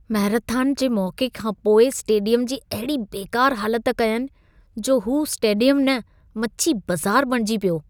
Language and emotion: Sindhi, disgusted